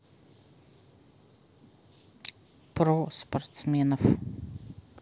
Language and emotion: Russian, neutral